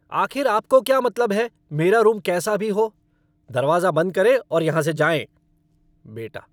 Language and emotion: Hindi, angry